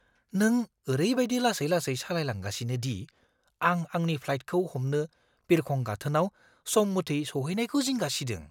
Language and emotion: Bodo, fearful